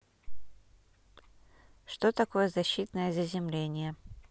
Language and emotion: Russian, neutral